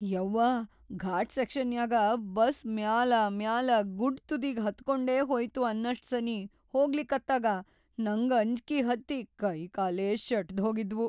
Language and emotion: Kannada, fearful